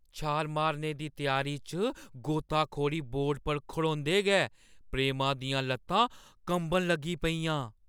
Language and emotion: Dogri, fearful